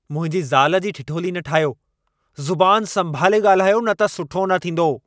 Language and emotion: Sindhi, angry